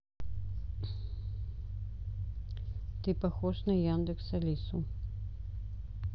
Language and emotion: Russian, neutral